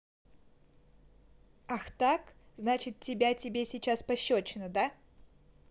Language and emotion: Russian, angry